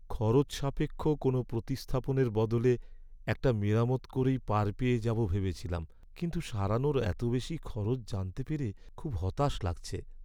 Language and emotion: Bengali, sad